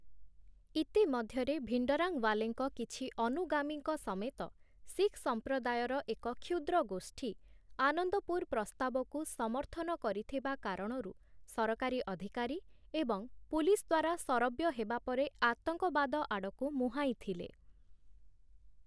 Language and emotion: Odia, neutral